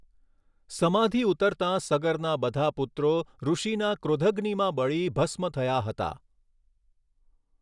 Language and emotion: Gujarati, neutral